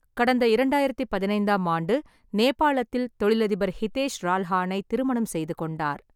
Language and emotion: Tamil, neutral